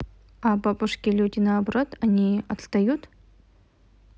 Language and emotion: Russian, neutral